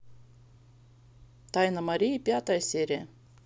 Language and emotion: Russian, neutral